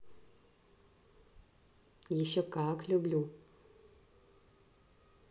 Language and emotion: Russian, positive